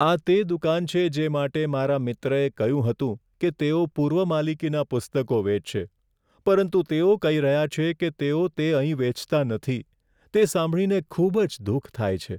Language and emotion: Gujarati, sad